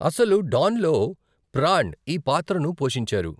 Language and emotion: Telugu, neutral